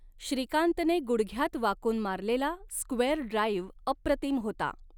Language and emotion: Marathi, neutral